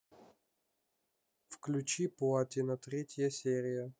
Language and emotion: Russian, neutral